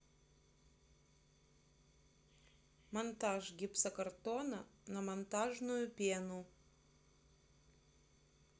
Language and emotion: Russian, neutral